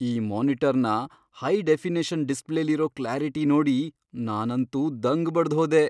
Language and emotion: Kannada, surprised